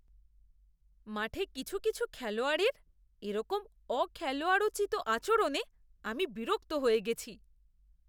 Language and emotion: Bengali, disgusted